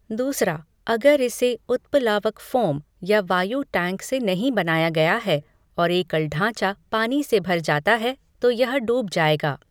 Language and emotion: Hindi, neutral